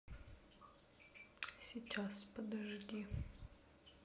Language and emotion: Russian, sad